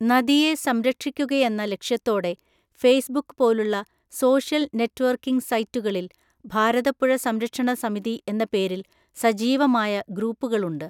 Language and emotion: Malayalam, neutral